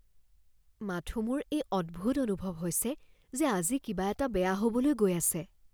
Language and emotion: Assamese, fearful